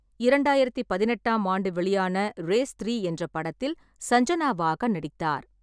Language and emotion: Tamil, neutral